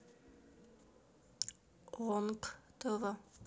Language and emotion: Russian, sad